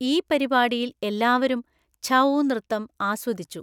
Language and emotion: Malayalam, neutral